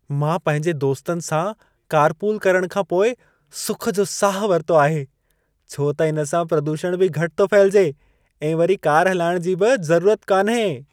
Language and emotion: Sindhi, happy